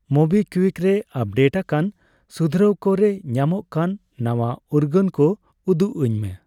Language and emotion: Santali, neutral